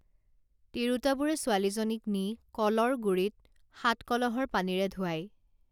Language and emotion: Assamese, neutral